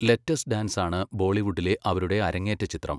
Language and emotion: Malayalam, neutral